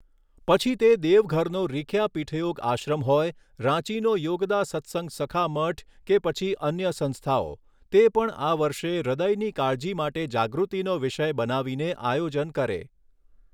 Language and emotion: Gujarati, neutral